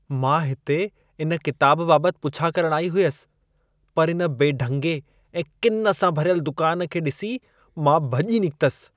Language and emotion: Sindhi, disgusted